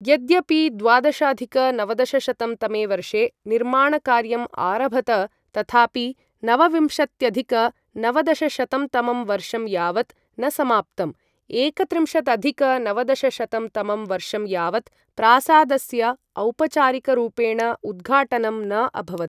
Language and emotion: Sanskrit, neutral